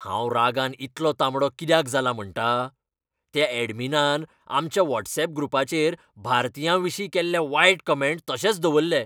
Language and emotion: Goan Konkani, angry